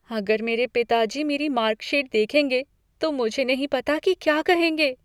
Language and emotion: Hindi, fearful